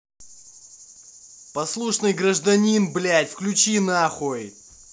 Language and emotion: Russian, angry